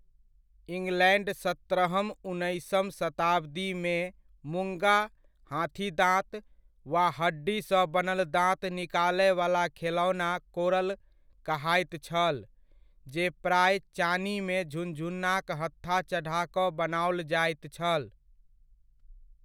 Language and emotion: Maithili, neutral